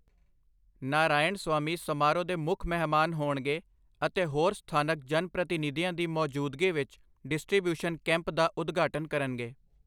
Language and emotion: Punjabi, neutral